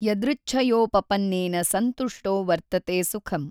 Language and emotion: Kannada, neutral